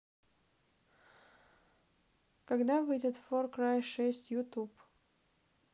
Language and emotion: Russian, sad